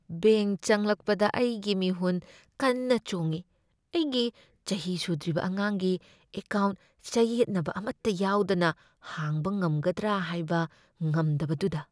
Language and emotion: Manipuri, fearful